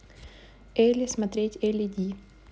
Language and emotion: Russian, neutral